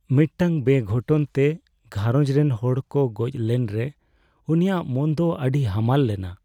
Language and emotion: Santali, sad